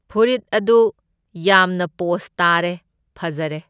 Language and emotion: Manipuri, neutral